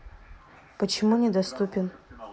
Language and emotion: Russian, neutral